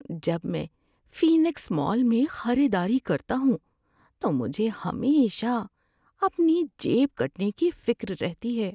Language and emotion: Urdu, fearful